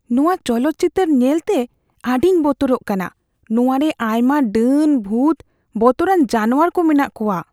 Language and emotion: Santali, fearful